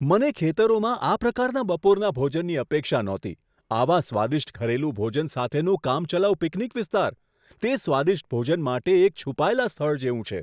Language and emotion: Gujarati, surprised